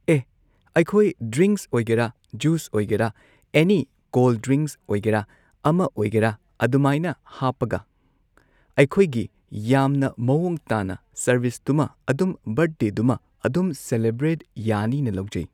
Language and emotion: Manipuri, neutral